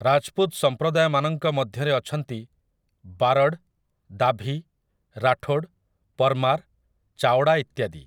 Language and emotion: Odia, neutral